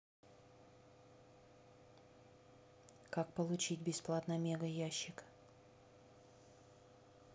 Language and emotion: Russian, neutral